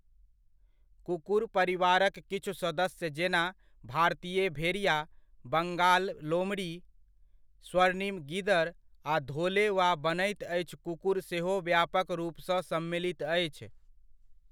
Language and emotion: Maithili, neutral